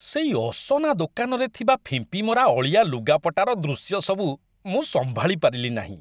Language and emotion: Odia, disgusted